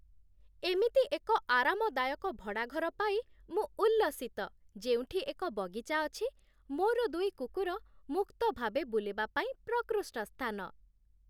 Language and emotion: Odia, happy